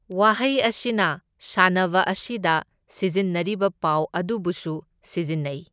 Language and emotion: Manipuri, neutral